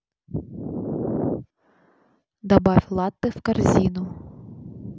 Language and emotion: Russian, neutral